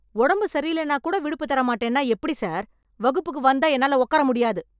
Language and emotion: Tamil, angry